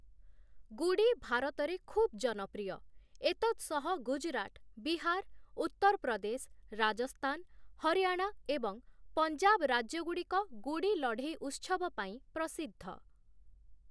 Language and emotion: Odia, neutral